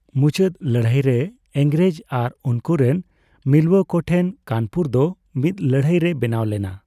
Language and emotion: Santali, neutral